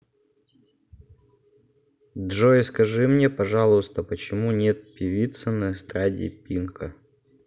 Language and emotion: Russian, neutral